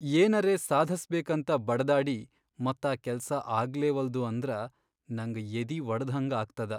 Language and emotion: Kannada, sad